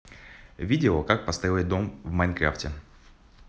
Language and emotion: Russian, positive